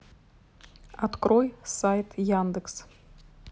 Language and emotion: Russian, neutral